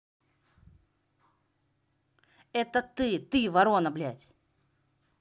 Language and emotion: Russian, angry